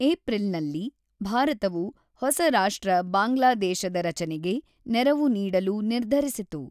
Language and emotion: Kannada, neutral